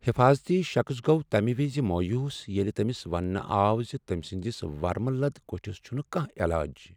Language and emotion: Kashmiri, sad